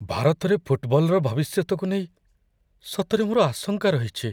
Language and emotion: Odia, fearful